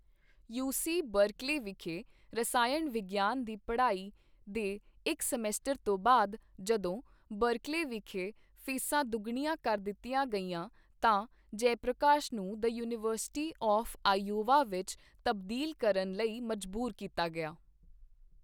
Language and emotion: Punjabi, neutral